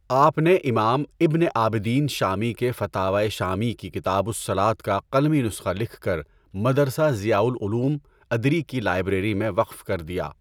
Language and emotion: Urdu, neutral